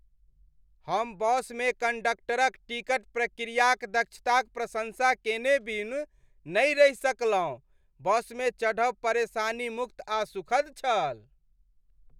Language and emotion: Maithili, happy